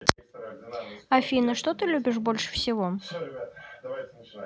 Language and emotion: Russian, neutral